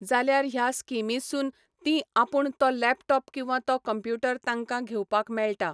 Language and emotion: Goan Konkani, neutral